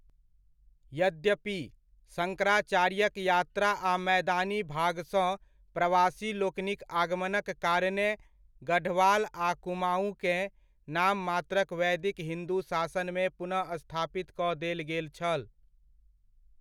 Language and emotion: Maithili, neutral